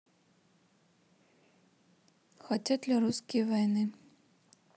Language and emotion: Russian, neutral